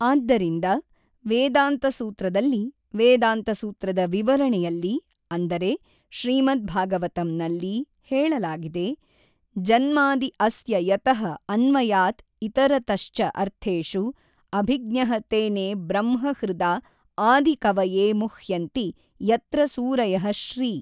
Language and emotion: Kannada, neutral